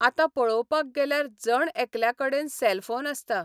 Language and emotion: Goan Konkani, neutral